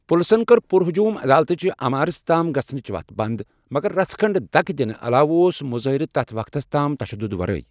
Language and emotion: Kashmiri, neutral